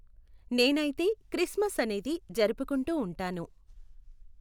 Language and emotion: Telugu, neutral